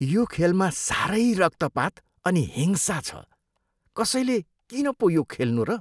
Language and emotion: Nepali, disgusted